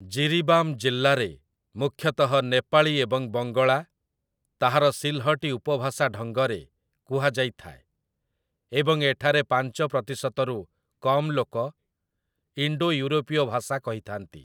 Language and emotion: Odia, neutral